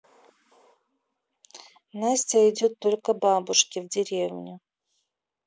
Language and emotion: Russian, neutral